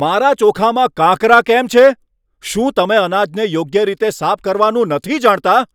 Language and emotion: Gujarati, angry